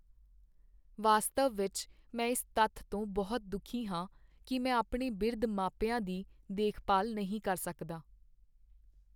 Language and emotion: Punjabi, sad